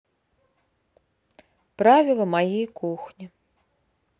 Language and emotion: Russian, neutral